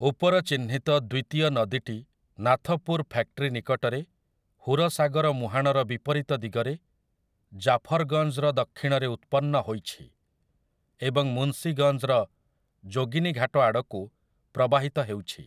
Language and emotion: Odia, neutral